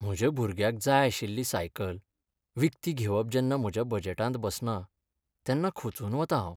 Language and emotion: Goan Konkani, sad